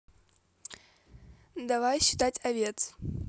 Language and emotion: Russian, positive